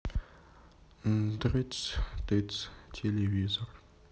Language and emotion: Russian, sad